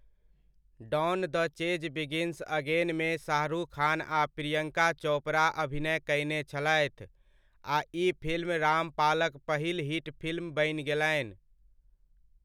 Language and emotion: Maithili, neutral